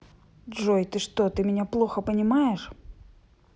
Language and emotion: Russian, angry